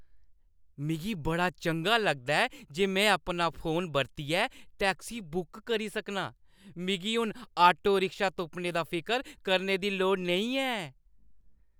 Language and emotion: Dogri, happy